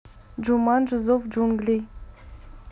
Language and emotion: Russian, neutral